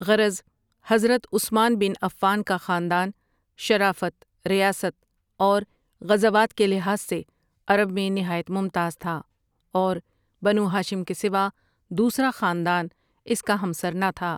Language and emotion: Urdu, neutral